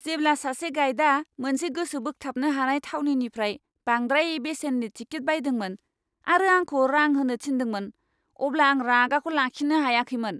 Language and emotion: Bodo, angry